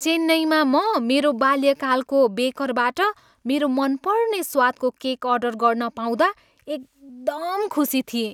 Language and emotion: Nepali, happy